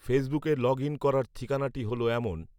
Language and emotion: Bengali, neutral